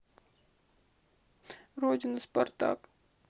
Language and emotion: Russian, sad